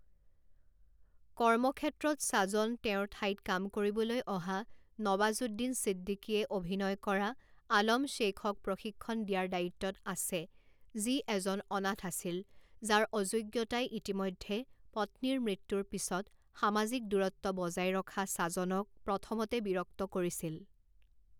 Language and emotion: Assamese, neutral